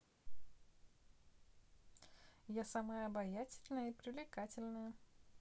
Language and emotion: Russian, positive